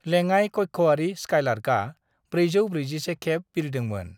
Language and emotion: Bodo, neutral